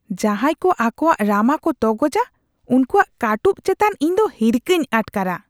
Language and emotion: Santali, disgusted